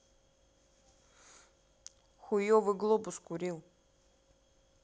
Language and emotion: Russian, neutral